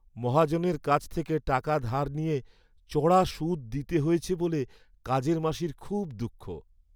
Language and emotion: Bengali, sad